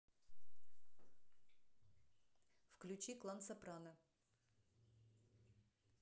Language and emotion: Russian, neutral